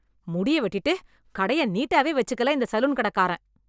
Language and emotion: Tamil, angry